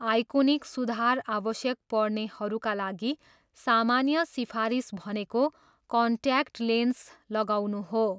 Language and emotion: Nepali, neutral